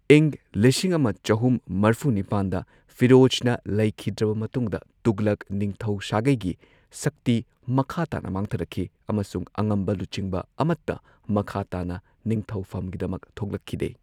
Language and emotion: Manipuri, neutral